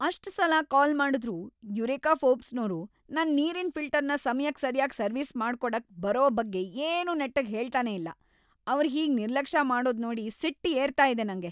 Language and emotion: Kannada, angry